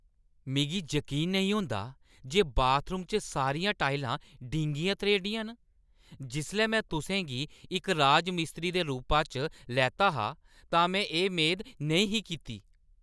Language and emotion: Dogri, angry